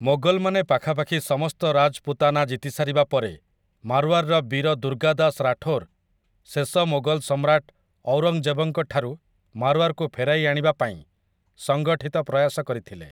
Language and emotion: Odia, neutral